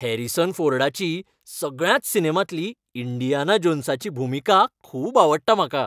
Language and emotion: Goan Konkani, happy